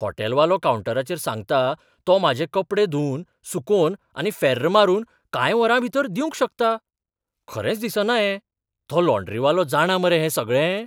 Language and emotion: Goan Konkani, surprised